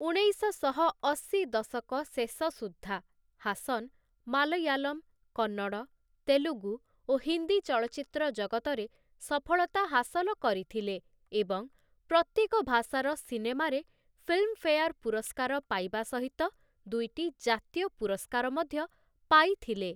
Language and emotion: Odia, neutral